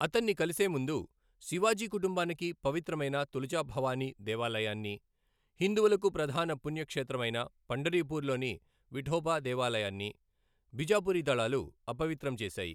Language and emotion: Telugu, neutral